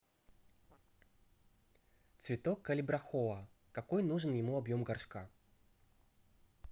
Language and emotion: Russian, neutral